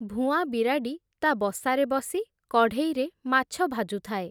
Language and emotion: Odia, neutral